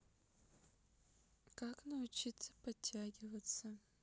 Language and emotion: Russian, neutral